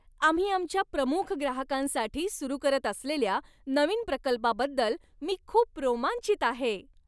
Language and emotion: Marathi, happy